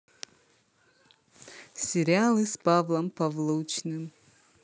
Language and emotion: Russian, positive